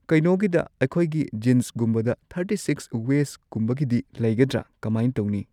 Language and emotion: Manipuri, neutral